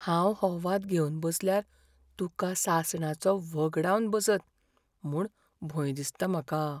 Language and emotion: Goan Konkani, fearful